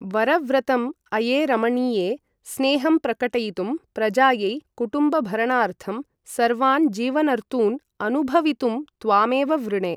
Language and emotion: Sanskrit, neutral